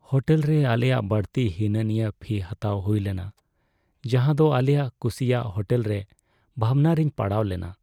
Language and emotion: Santali, sad